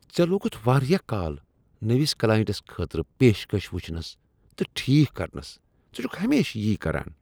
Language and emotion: Kashmiri, disgusted